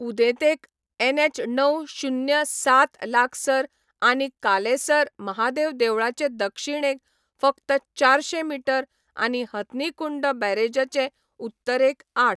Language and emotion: Goan Konkani, neutral